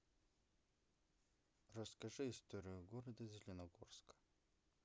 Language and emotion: Russian, neutral